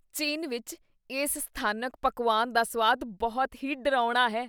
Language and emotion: Punjabi, disgusted